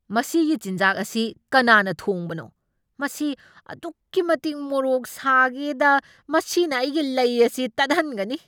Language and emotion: Manipuri, angry